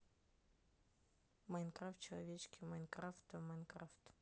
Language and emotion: Russian, neutral